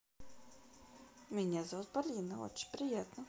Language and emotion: Russian, positive